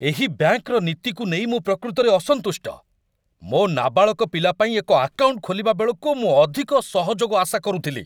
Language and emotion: Odia, angry